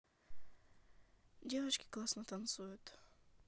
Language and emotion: Russian, neutral